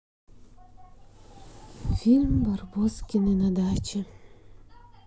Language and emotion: Russian, sad